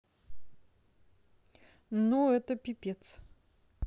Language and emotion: Russian, neutral